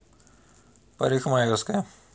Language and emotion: Russian, neutral